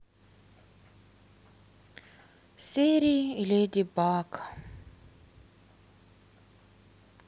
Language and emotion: Russian, sad